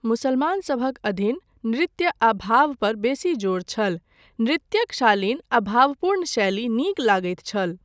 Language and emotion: Maithili, neutral